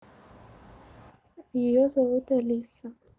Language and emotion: Russian, neutral